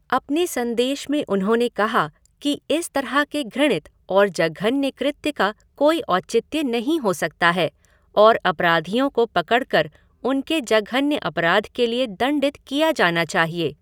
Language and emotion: Hindi, neutral